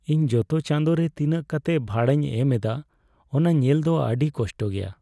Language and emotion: Santali, sad